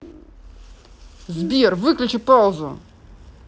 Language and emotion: Russian, angry